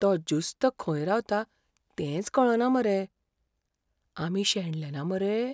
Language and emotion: Goan Konkani, fearful